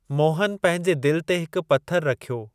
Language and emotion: Sindhi, neutral